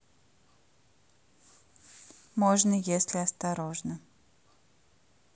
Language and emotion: Russian, neutral